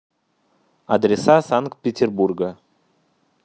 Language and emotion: Russian, neutral